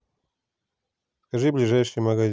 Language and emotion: Russian, neutral